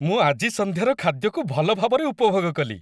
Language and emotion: Odia, happy